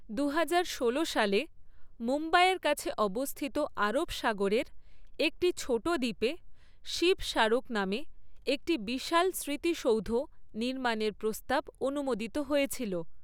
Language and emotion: Bengali, neutral